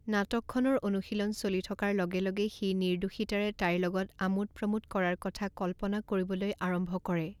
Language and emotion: Assamese, neutral